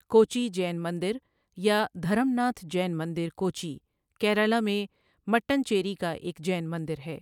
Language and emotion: Urdu, neutral